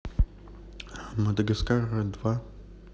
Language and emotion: Russian, neutral